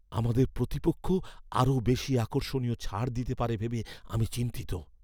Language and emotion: Bengali, fearful